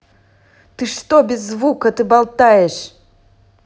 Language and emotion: Russian, angry